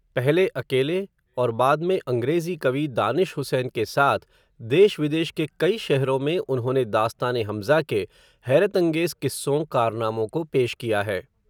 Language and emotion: Hindi, neutral